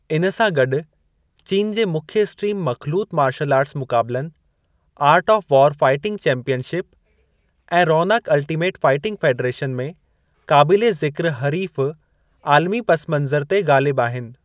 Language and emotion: Sindhi, neutral